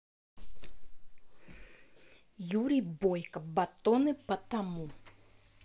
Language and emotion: Russian, neutral